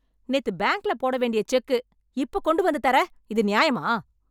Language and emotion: Tamil, angry